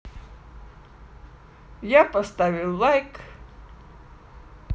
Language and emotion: Russian, positive